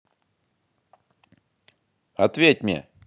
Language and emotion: Russian, angry